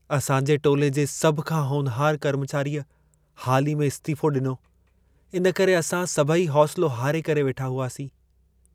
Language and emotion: Sindhi, sad